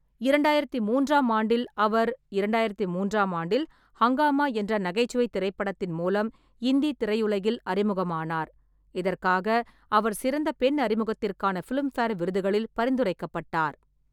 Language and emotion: Tamil, neutral